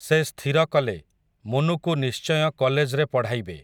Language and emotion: Odia, neutral